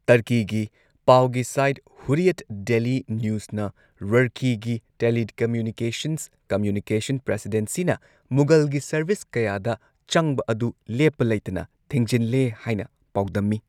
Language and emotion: Manipuri, neutral